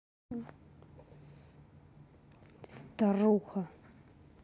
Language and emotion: Russian, angry